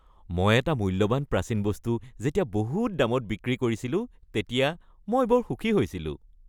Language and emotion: Assamese, happy